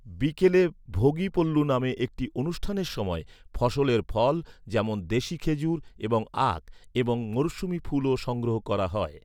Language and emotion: Bengali, neutral